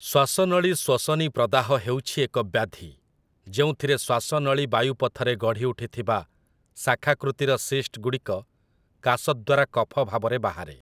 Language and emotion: Odia, neutral